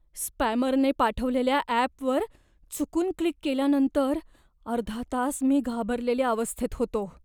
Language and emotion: Marathi, fearful